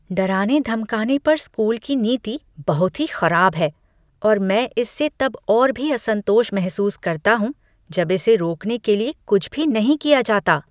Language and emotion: Hindi, disgusted